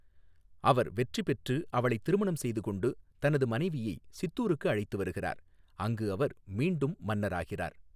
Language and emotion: Tamil, neutral